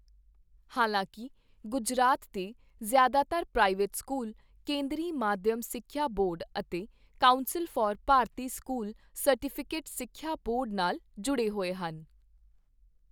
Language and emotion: Punjabi, neutral